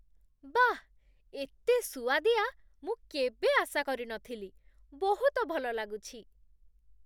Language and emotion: Odia, surprised